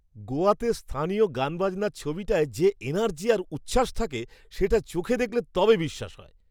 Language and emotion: Bengali, surprised